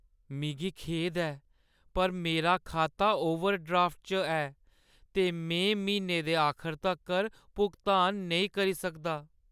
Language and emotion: Dogri, sad